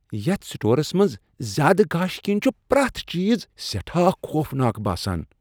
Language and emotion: Kashmiri, disgusted